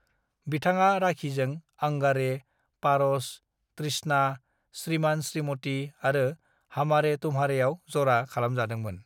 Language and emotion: Bodo, neutral